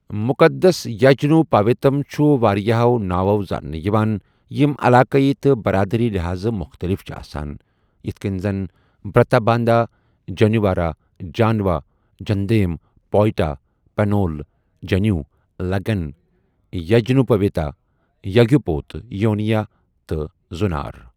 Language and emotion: Kashmiri, neutral